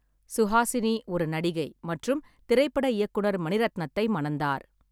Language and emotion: Tamil, neutral